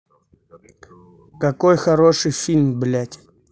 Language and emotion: Russian, angry